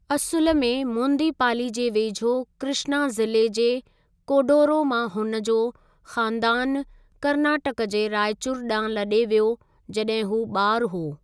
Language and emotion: Sindhi, neutral